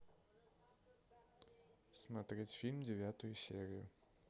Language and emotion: Russian, neutral